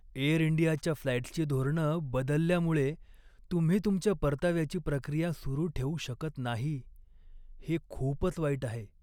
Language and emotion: Marathi, sad